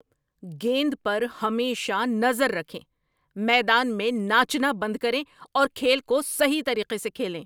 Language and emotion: Urdu, angry